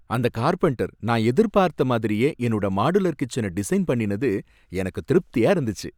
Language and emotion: Tamil, happy